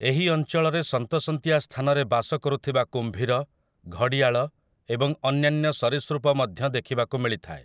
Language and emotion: Odia, neutral